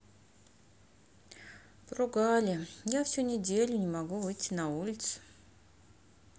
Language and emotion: Russian, sad